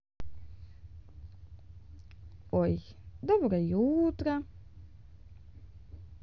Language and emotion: Russian, positive